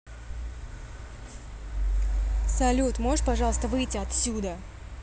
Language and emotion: Russian, angry